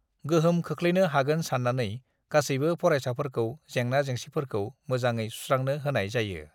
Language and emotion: Bodo, neutral